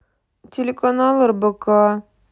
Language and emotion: Russian, sad